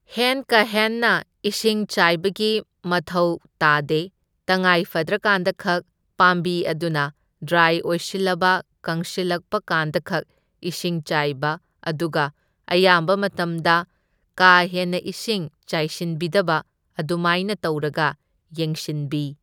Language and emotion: Manipuri, neutral